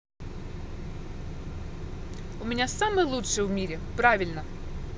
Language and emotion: Russian, positive